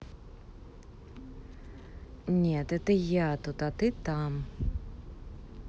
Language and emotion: Russian, neutral